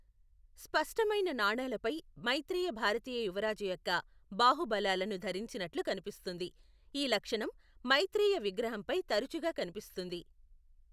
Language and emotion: Telugu, neutral